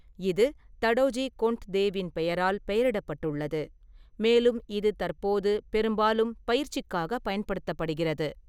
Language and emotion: Tamil, neutral